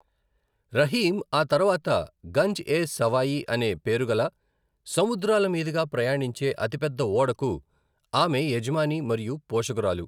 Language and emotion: Telugu, neutral